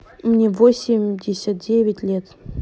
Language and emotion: Russian, neutral